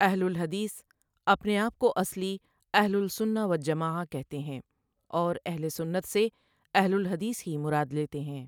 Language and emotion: Urdu, neutral